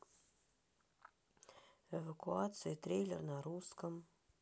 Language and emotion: Russian, sad